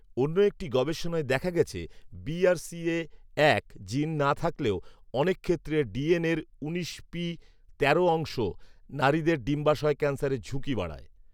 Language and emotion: Bengali, neutral